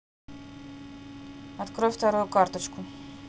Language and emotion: Russian, neutral